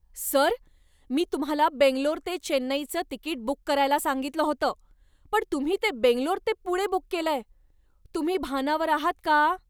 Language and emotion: Marathi, angry